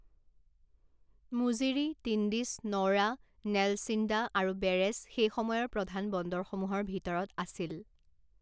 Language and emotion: Assamese, neutral